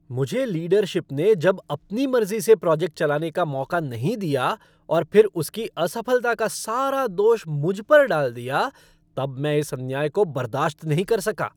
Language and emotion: Hindi, angry